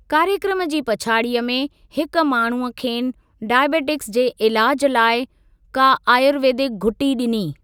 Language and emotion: Sindhi, neutral